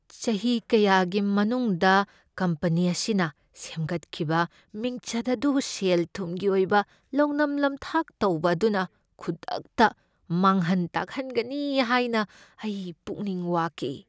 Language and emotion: Manipuri, fearful